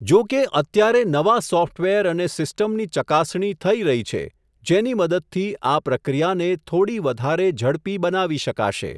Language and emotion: Gujarati, neutral